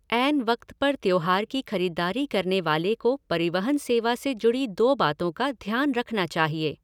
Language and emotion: Hindi, neutral